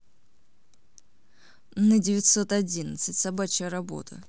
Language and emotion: Russian, neutral